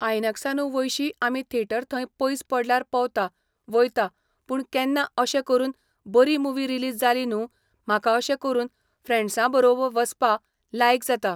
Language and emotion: Goan Konkani, neutral